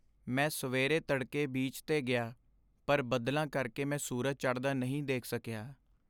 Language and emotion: Punjabi, sad